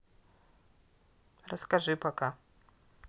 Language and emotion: Russian, neutral